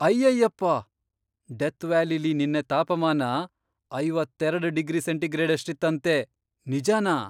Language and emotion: Kannada, surprised